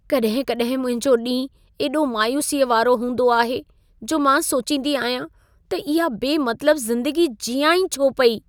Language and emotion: Sindhi, sad